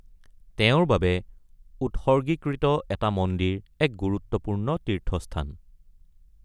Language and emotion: Assamese, neutral